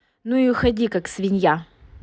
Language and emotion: Russian, angry